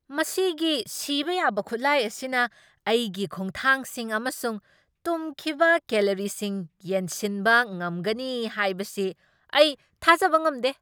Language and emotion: Manipuri, surprised